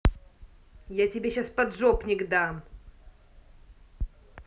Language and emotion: Russian, angry